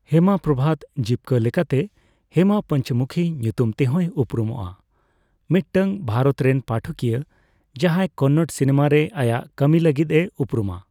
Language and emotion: Santali, neutral